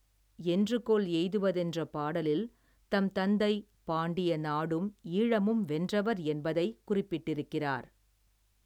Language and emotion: Tamil, neutral